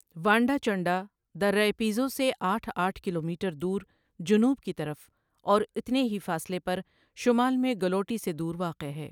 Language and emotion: Urdu, neutral